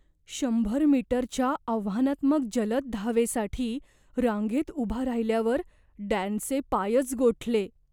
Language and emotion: Marathi, fearful